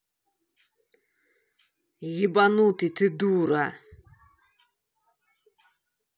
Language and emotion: Russian, angry